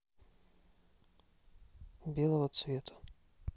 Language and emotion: Russian, neutral